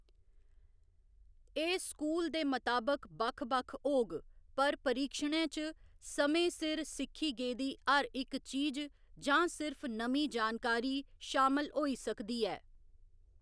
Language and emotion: Dogri, neutral